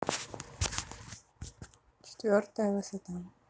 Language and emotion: Russian, neutral